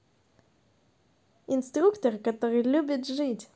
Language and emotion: Russian, positive